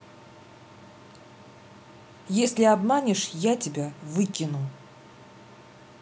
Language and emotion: Russian, angry